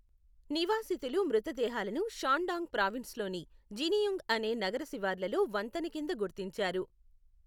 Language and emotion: Telugu, neutral